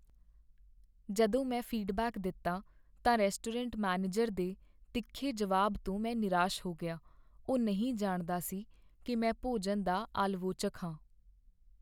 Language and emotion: Punjabi, sad